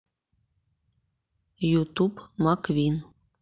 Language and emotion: Russian, neutral